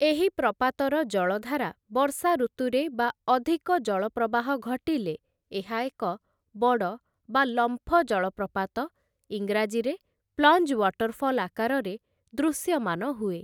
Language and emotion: Odia, neutral